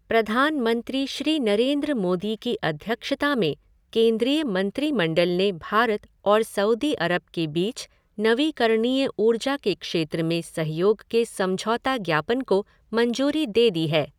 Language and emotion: Hindi, neutral